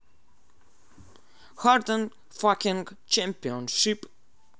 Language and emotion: Russian, positive